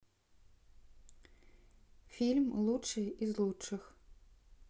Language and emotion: Russian, neutral